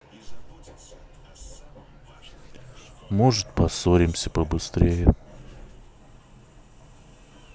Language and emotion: Russian, neutral